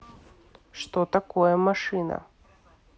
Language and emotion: Russian, neutral